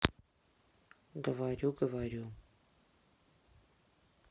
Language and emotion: Russian, sad